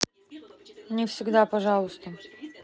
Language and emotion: Russian, neutral